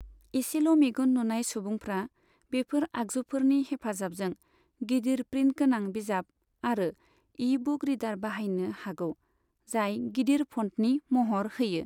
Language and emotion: Bodo, neutral